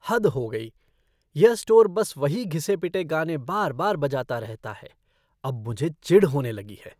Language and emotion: Hindi, disgusted